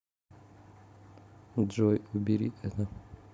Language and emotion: Russian, sad